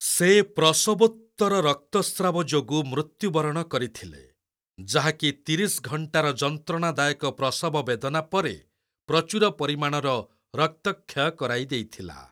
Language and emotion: Odia, neutral